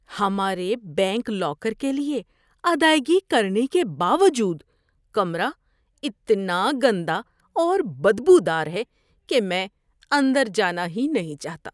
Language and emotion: Urdu, disgusted